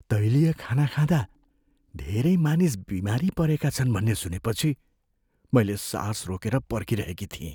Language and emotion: Nepali, fearful